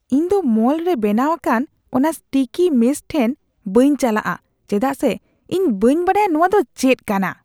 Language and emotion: Santali, disgusted